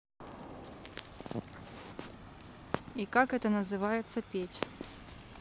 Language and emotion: Russian, neutral